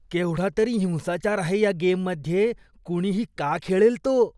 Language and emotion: Marathi, disgusted